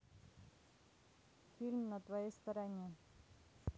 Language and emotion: Russian, neutral